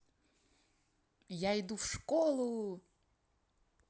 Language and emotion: Russian, positive